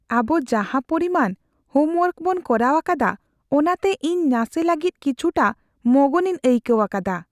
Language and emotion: Santali, fearful